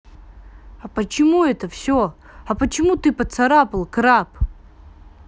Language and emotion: Russian, angry